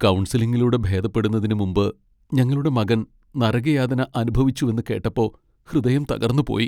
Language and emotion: Malayalam, sad